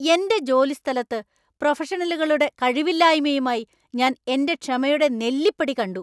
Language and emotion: Malayalam, angry